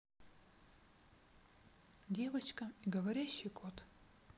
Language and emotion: Russian, neutral